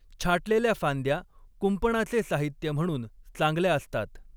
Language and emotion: Marathi, neutral